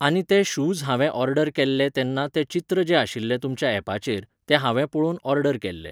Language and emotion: Goan Konkani, neutral